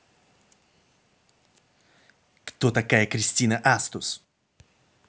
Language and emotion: Russian, angry